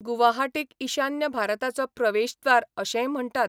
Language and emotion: Goan Konkani, neutral